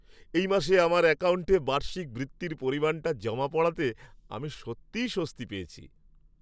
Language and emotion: Bengali, happy